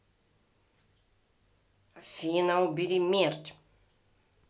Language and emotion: Russian, angry